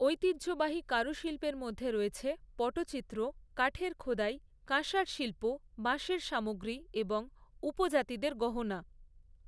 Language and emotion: Bengali, neutral